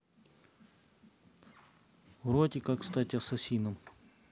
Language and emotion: Russian, neutral